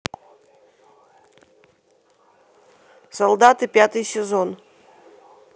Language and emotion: Russian, neutral